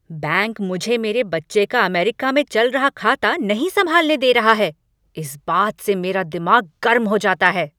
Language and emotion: Hindi, angry